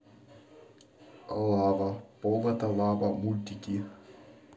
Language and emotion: Russian, neutral